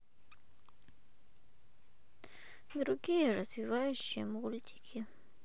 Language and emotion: Russian, sad